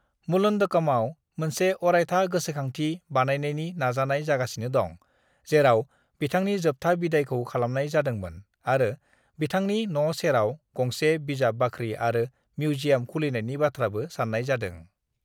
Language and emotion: Bodo, neutral